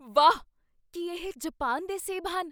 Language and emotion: Punjabi, surprised